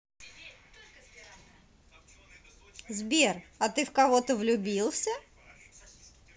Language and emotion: Russian, positive